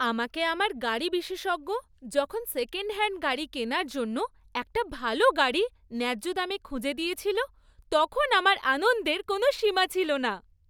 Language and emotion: Bengali, happy